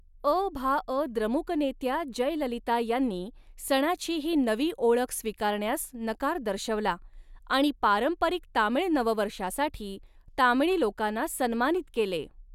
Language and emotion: Marathi, neutral